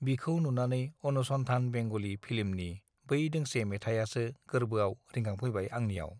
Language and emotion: Bodo, neutral